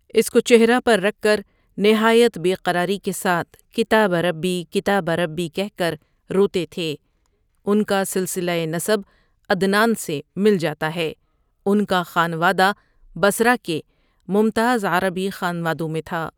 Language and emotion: Urdu, neutral